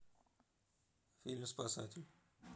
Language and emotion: Russian, neutral